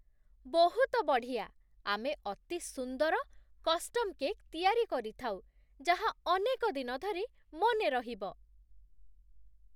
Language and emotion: Odia, surprised